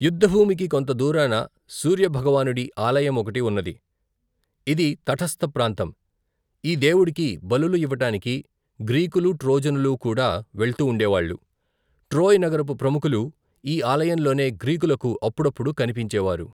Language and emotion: Telugu, neutral